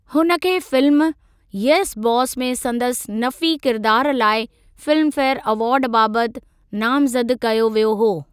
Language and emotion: Sindhi, neutral